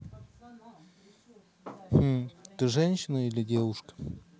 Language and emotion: Russian, neutral